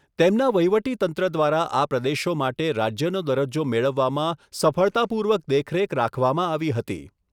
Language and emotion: Gujarati, neutral